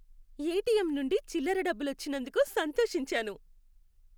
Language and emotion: Telugu, happy